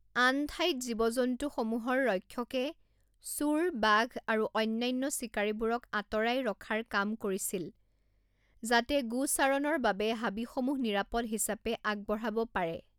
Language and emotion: Assamese, neutral